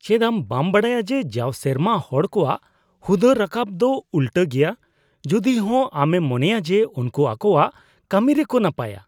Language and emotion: Santali, disgusted